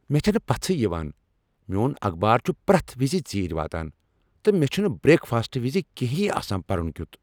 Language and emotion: Kashmiri, angry